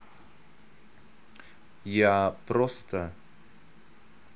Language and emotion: Russian, neutral